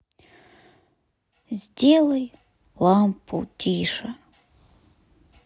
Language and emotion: Russian, sad